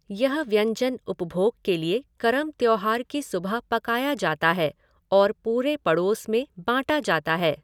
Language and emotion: Hindi, neutral